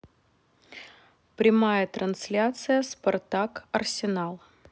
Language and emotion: Russian, neutral